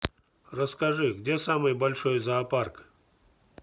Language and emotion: Russian, neutral